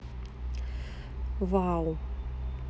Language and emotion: Russian, neutral